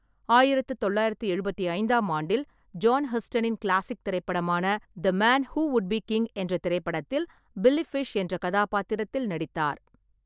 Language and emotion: Tamil, neutral